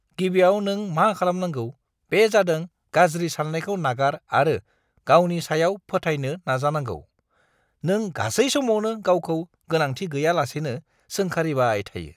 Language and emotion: Bodo, disgusted